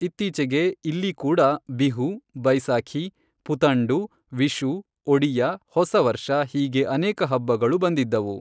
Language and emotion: Kannada, neutral